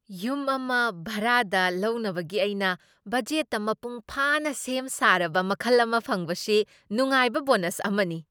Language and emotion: Manipuri, surprised